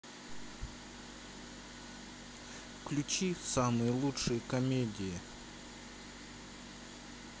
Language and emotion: Russian, neutral